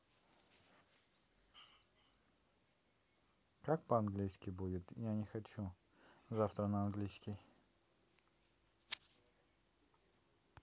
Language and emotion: Russian, neutral